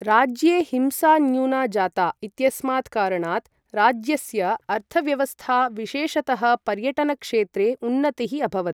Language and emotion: Sanskrit, neutral